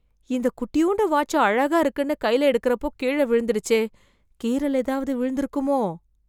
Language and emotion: Tamil, fearful